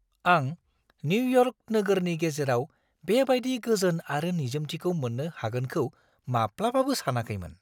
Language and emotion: Bodo, surprised